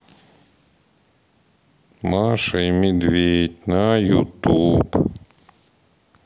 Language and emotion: Russian, sad